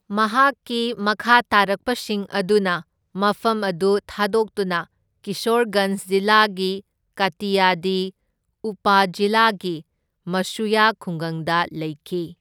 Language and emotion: Manipuri, neutral